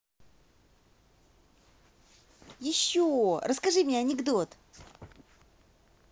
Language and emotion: Russian, positive